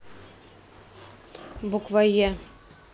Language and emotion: Russian, neutral